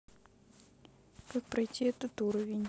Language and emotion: Russian, neutral